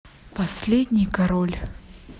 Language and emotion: Russian, sad